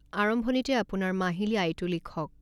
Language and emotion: Assamese, neutral